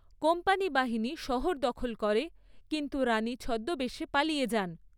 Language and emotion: Bengali, neutral